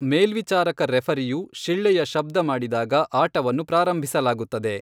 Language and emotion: Kannada, neutral